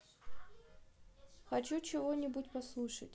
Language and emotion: Russian, neutral